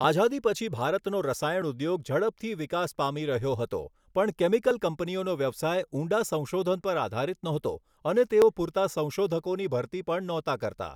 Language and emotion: Gujarati, neutral